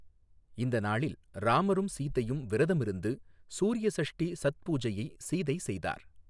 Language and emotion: Tamil, neutral